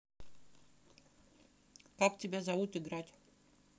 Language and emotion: Russian, neutral